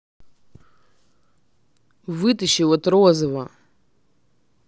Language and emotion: Russian, angry